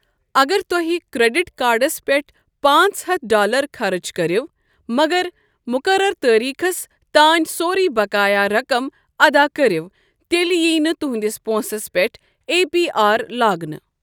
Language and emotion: Kashmiri, neutral